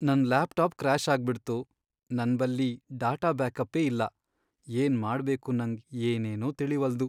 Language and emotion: Kannada, sad